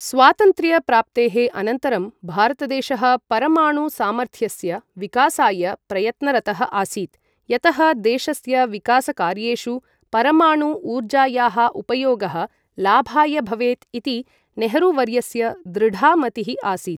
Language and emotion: Sanskrit, neutral